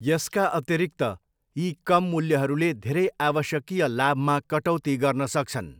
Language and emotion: Nepali, neutral